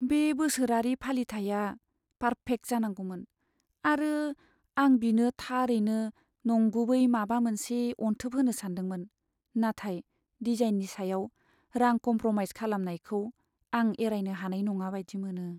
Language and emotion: Bodo, sad